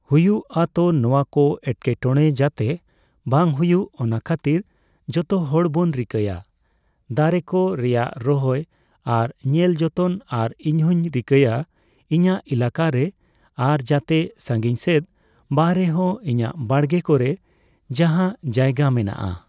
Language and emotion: Santali, neutral